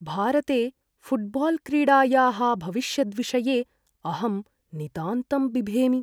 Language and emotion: Sanskrit, fearful